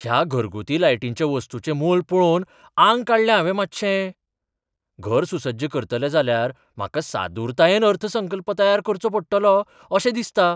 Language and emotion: Goan Konkani, surprised